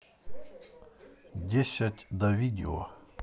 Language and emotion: Russian, neutral